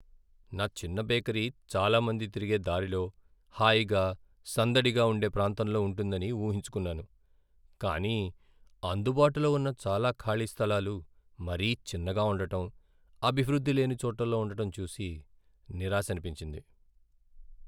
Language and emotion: Telugu, sad